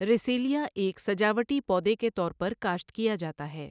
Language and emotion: Urdu, neutral